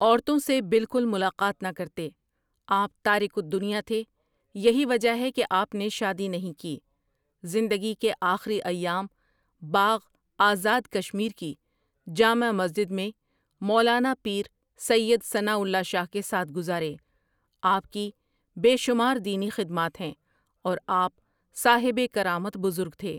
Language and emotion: Urdu, neutral